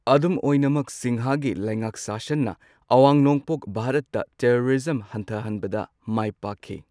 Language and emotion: Manipuri, neutral